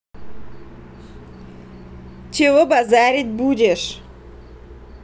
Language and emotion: Russian, angry